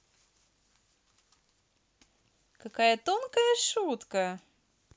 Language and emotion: Russian, positive